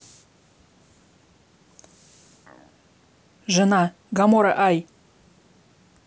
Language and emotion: Russian, neutral